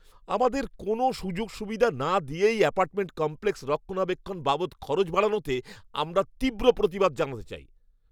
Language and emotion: Bengali, angry